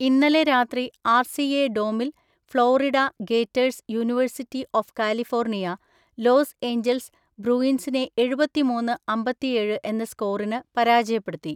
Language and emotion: Malayalam, neutral